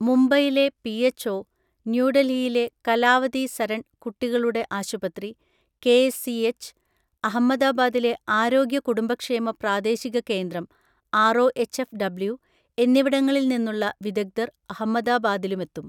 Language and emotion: Malayalam, neutral